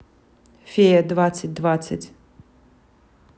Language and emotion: Russian, neutral